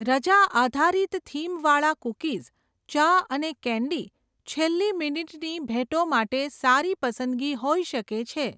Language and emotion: Gujarati, neutral